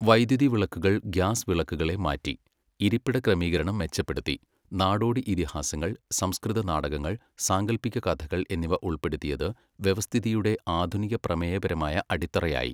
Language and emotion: Malayalam, neutral